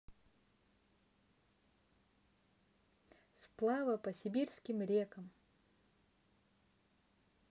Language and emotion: Russian, neutral